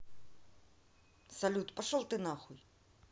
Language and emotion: Russian, angry